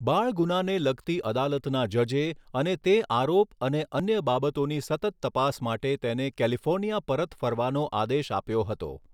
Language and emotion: Gujarati, neutral